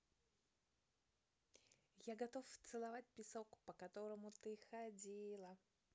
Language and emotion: Russian, positive